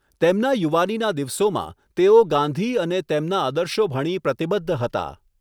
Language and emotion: Gujarati, neutral